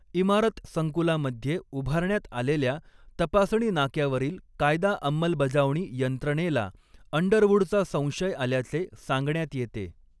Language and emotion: Marathi, neutral